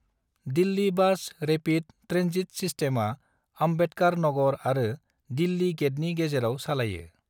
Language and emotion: Bodo, neutral